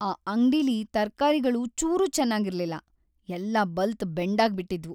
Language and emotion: Kannada, sad